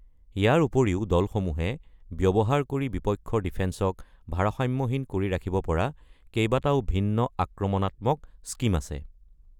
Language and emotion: Assamese, neutral